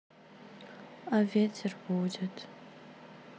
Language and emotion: Russian, sad